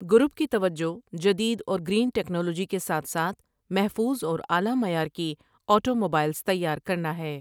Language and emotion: Urdu, neutral